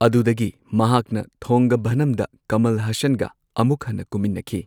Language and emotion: Manipuri, neutral